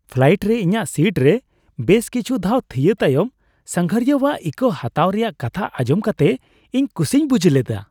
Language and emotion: Santali, happy